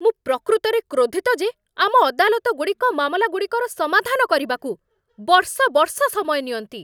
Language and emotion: Odia, angry